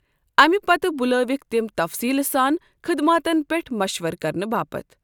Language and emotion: Kashmiri, neutral